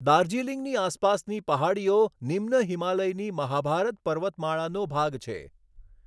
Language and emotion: Gujarati, neutral